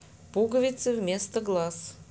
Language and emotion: Russian, neutral